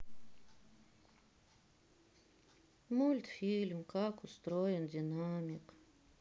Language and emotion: Russian, sad